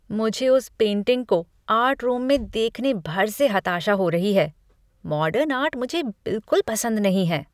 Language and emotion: Hindi, disgusted